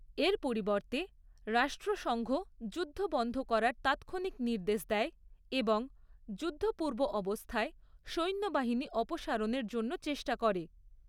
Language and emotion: Bengali, neutral